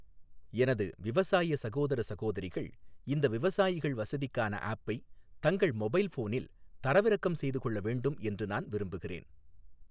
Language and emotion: Tamil, neutral